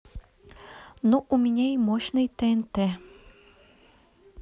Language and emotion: Russian, neutral